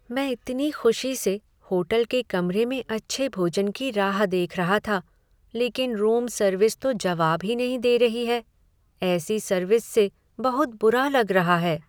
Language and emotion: Hindi, sad